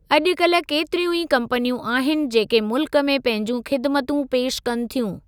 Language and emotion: Sindhi, neutral